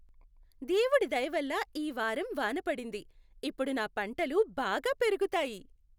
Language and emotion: Telugu, happy